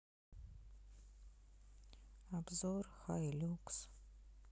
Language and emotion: Russian, sad